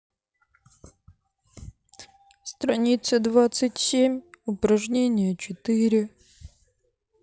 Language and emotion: Russian, sad